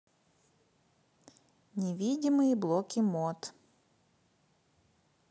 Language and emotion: Russian, neutral